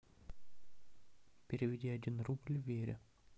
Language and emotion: Russian, neutral